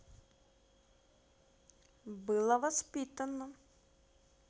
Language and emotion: Russian, neutral